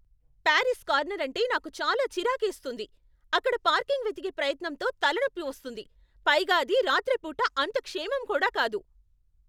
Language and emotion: Telugu, angry